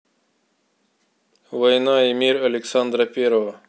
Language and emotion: Russian, neutral